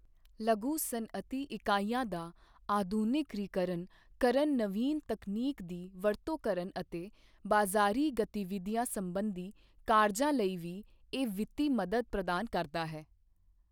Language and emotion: Punjabi, neutral